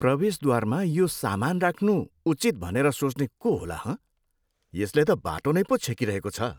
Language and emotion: Nepali, disgusted